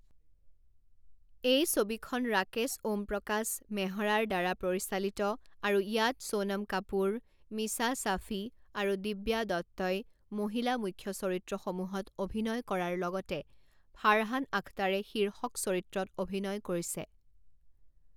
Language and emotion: Assamese, neutral